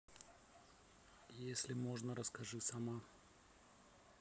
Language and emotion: Russian, neutral